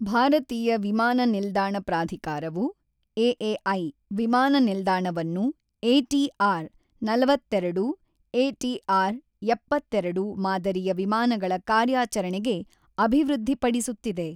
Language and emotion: Kannada, neutral